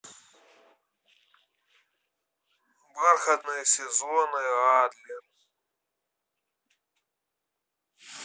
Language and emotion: Russian, neutral